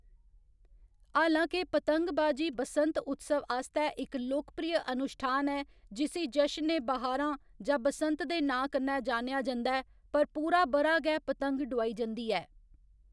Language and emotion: Dogri, neutral